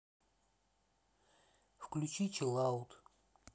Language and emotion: Russian, sad